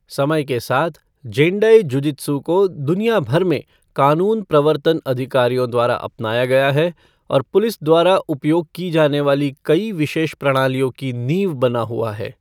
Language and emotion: Hindi, neutral